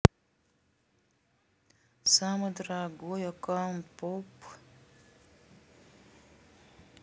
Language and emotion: Russian, neutral